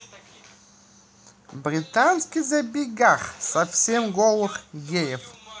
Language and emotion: Russian, positive